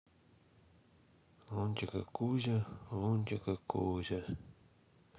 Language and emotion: Russian, sad